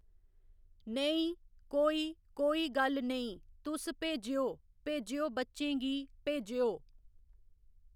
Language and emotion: Dogri, neutral